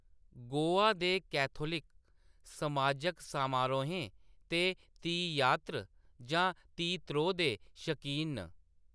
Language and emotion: Dogri, neutral